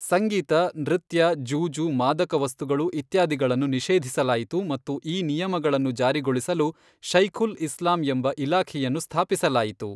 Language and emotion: Kannada, neutral